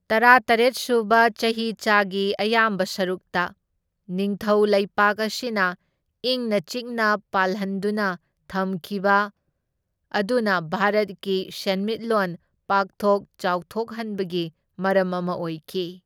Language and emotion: Manipuri, neutral